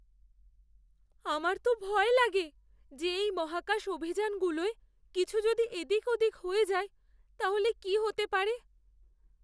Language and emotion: Bengali, fearful